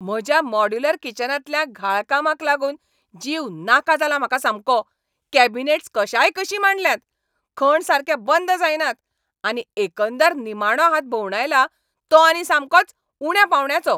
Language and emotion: Goan Konkani, angry